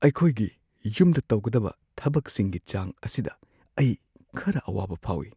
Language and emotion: Manipuri, fearful